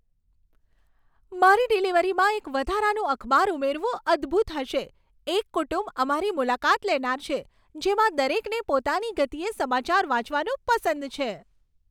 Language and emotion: Gujarati, happy